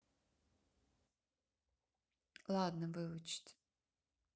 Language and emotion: Russian, neutral